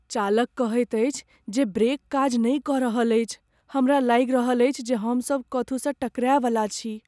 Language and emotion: Maithili, fearful